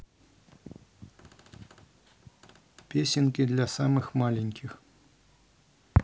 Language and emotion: Russian, neutral